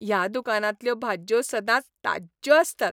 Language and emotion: Goan Konkani, happy